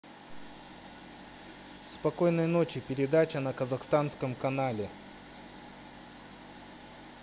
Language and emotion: Russian, neutral